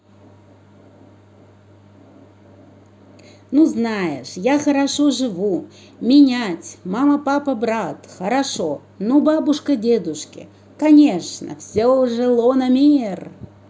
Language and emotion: Russian, positive